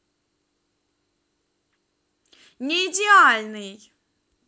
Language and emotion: Russian, angry